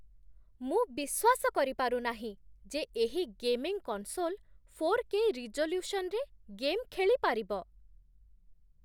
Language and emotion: Odia, surprised